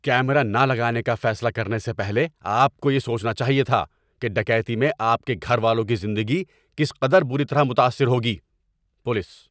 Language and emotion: Urdu, angry